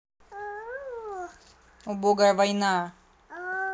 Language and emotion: Russian, angry